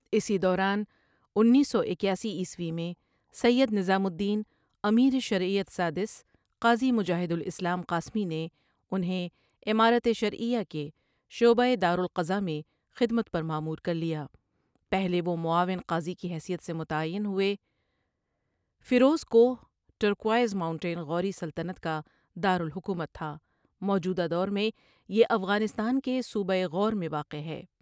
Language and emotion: Urdu, neutral